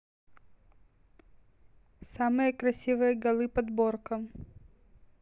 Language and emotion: Russian, neutral